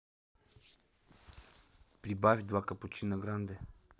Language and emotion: Russian, neutral